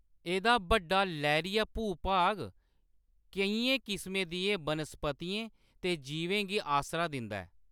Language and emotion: Dogri, neutral